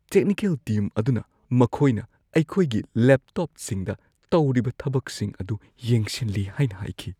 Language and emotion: Manipuri, fearful